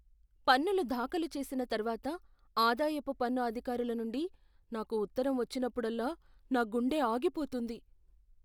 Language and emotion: Telugu, fearful